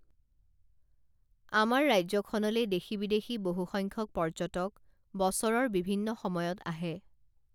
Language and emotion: Assamese, neutral